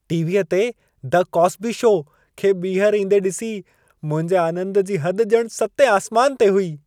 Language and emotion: Sindhi, happy